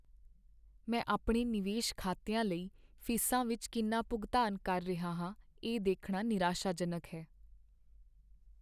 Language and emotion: Punjabi, sad